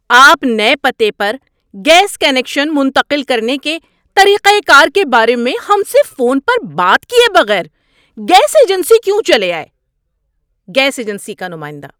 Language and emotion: Urdu, angry